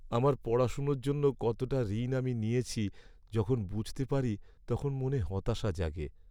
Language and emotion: Bengali, sad